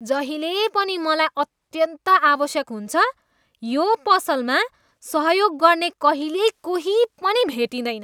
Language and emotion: Nepali, disgusted